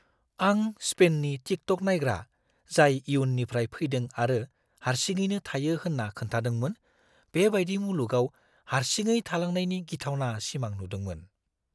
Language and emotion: Bodo, fearful